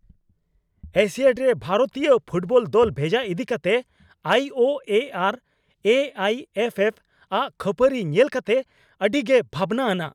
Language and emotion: Santali, angry